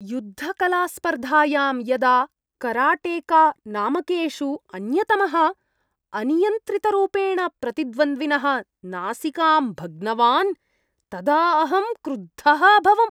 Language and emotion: Sanskrit, disgusted